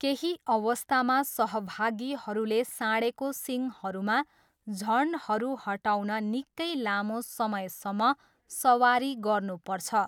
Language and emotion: Nepali, neutral